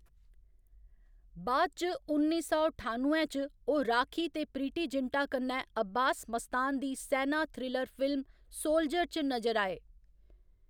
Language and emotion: Dogri, neutral